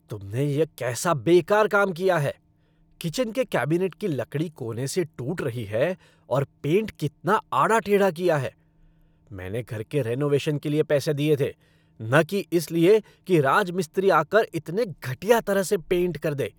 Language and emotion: Hindi, angry